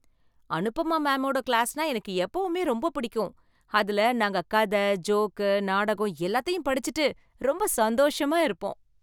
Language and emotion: Tamil, happy